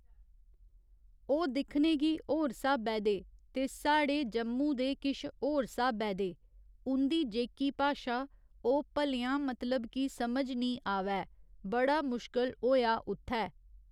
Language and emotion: Dogri, neutral